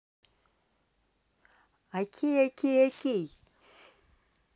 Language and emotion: Russian, positive